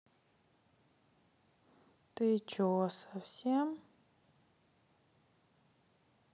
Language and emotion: Russian, sad